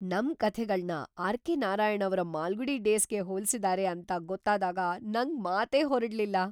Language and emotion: Kannada, surprised